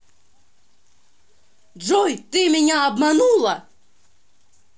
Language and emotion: Russian, angry